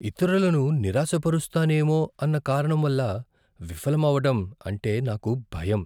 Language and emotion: Telugu, fearful